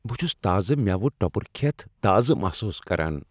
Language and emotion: Kashmiri, happy